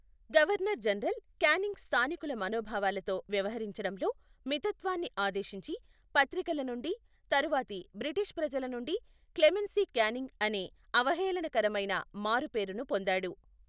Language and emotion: Telugu, neutral